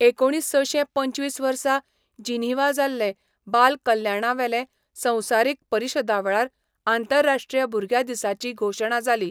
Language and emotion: Goan Konkani, neutral